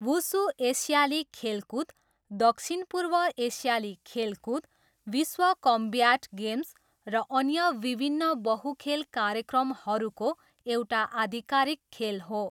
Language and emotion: Nepali, neutral